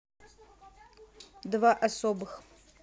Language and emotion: Russian, neutral